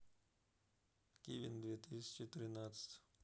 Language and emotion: Russian, neutral